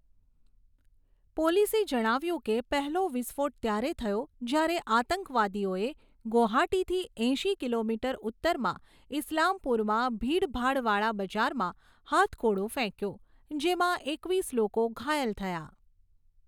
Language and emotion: Gujarati, neutral